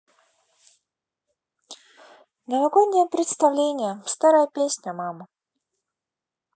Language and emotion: Russian, neutral